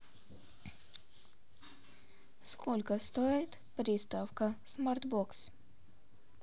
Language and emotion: Russian, neutral